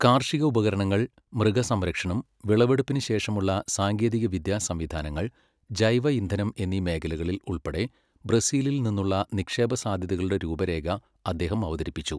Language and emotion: Malayalam, neutral